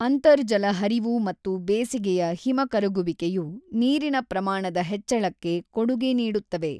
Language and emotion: Kannada, neutral